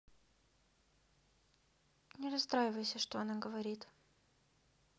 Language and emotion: Russian, sad